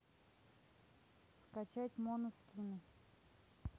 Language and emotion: Russian, neutral